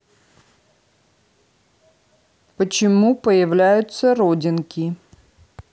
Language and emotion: Russian, neutral